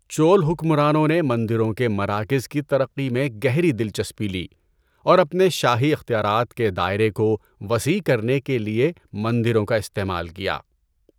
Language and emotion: Urdu, neutral